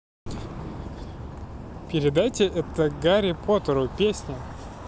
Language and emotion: Russian, positive